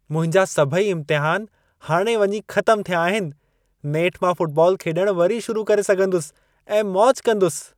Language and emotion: Sindhi, happy